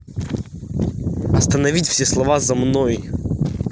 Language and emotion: Russian, angry